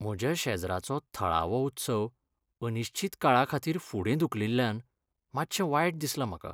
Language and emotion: Goan Konkani, sad